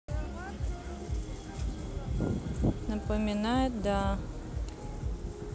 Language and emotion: Russian, neutral